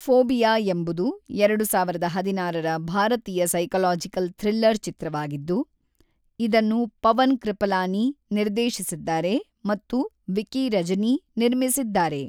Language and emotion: Kannada, neutral